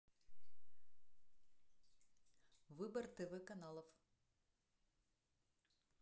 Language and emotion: Russian, neutral